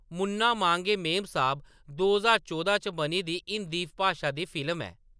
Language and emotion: Dogri, neutral